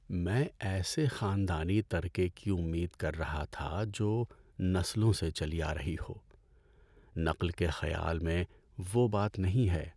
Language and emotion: Urdu, sad